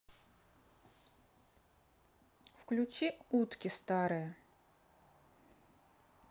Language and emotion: Russian, neutral